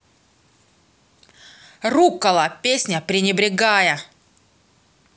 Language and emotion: Russian, neutral